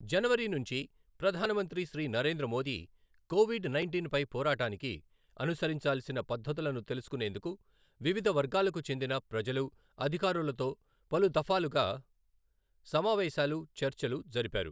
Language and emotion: Telugu, neutral